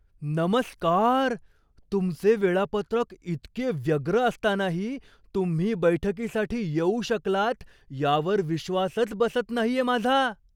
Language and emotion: Marathi, surprised